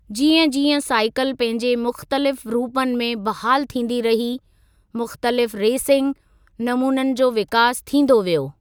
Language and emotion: Sindhi, neutral